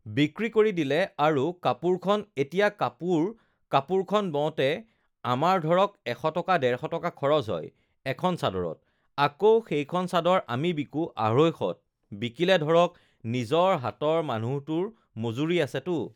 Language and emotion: Assamese, neutral